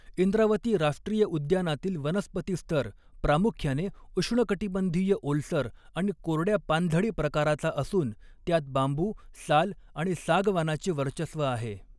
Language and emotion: Marathi, neutral